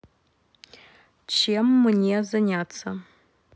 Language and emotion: Russian, neutral